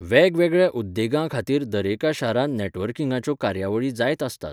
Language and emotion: Goan Konkani, neutral